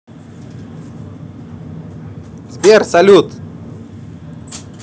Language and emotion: Russian, positive